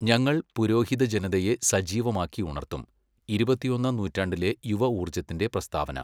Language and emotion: Malayalam, neutral